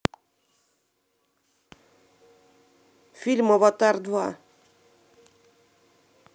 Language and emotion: Russian, neutral